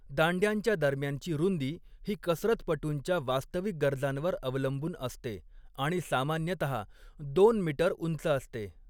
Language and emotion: Marathi, neutral